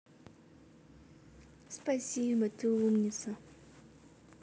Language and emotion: Russian, positive